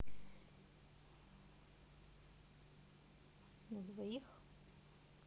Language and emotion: Russian, neutral